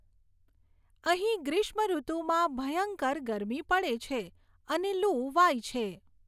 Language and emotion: Gujarati, neutral